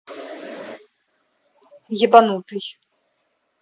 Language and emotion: Russian, angry